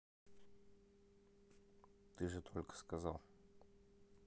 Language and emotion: Russian, neutral